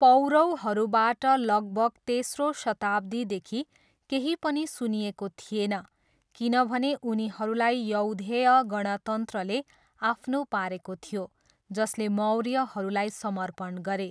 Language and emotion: Nepali, neutral